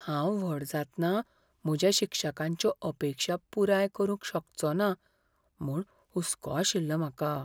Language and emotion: Goan Konkani, fearful